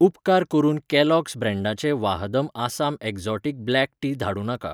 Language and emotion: Goan Konkani, neutral